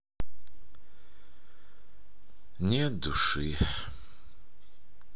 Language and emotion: Russian, sad